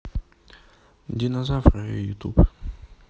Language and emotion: Russian, neutral